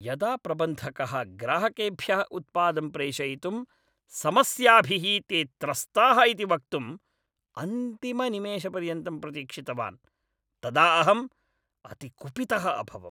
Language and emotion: Sanskrit, angry